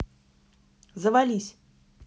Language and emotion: Russian, angry